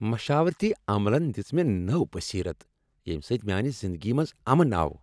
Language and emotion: Kashmiri, happy